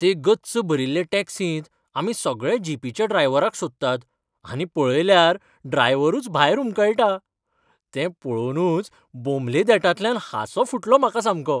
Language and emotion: Goan Konkani, happy